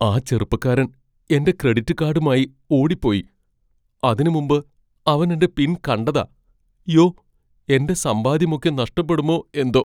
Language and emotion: Malayalam, fearful